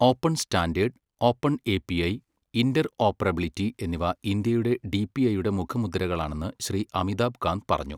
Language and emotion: Malayalam, neutral